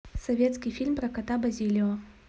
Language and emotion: Russian, neutral